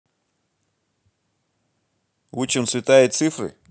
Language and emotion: Russian, positive